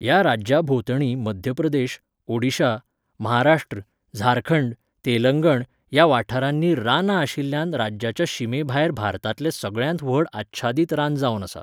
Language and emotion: Goan Konkani, neutral